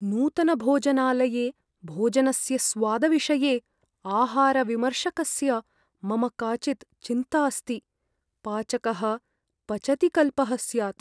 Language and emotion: Sanskrit, fearful